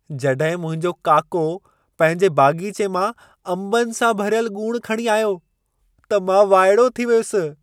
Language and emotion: Sindhi, surprised